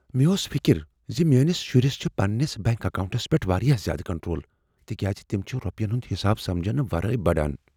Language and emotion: Kashmiri, fearful